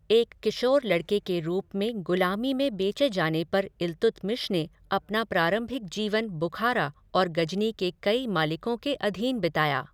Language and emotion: Hindi, neutral